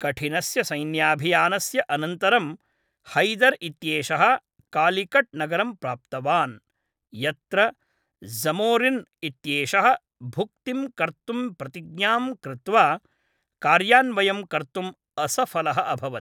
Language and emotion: Sanskrit, neutral